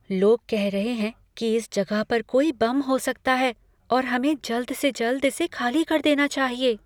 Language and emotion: Hindi, fearful